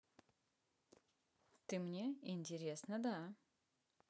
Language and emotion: Russian, neutral